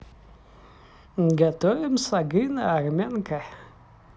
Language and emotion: Russian, positive